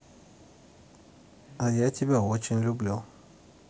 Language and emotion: Russian, positive